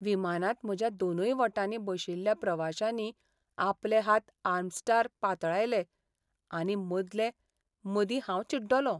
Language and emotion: Goan Konkani, sad